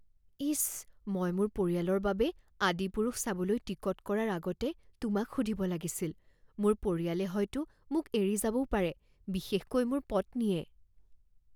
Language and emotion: Assamese, fearful